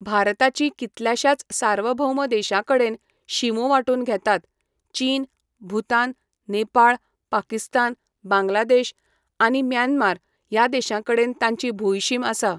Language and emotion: Goan Konkani, neutral